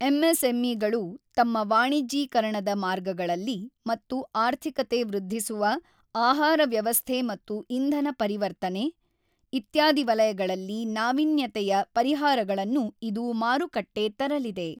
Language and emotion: Kannada, neutral